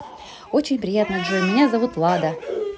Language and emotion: Russian, positive